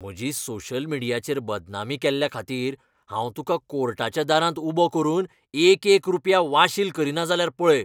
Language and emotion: Goan Konkani, angry